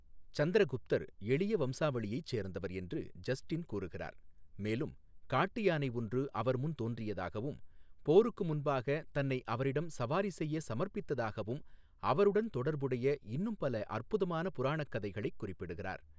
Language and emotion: Tamil, neutral